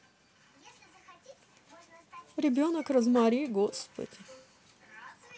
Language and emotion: Russian, neutral